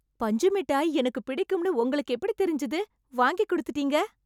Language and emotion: Tamil, happy